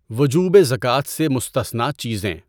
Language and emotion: Urdu, neutral